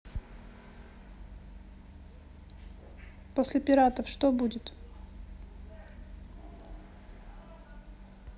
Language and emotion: Russian, neutral